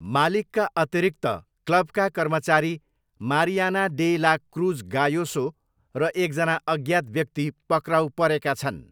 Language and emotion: Nepali, neutral